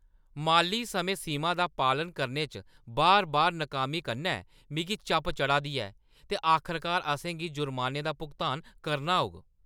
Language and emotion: Dogri, angry